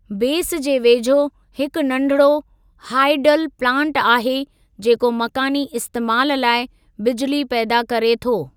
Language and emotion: Sindhi, neutral